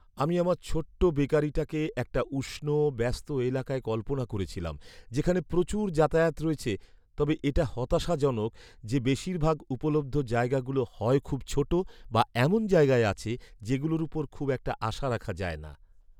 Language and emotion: Bengali, sad